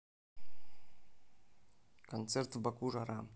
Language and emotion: Russian, neutral